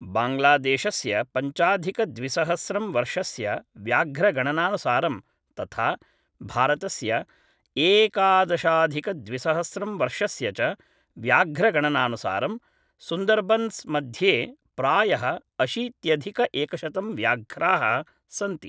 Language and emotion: Sanskrit, neutral